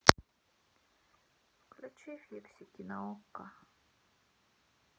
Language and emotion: Russian, sad